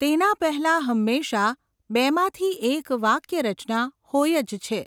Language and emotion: Gujarati, neutral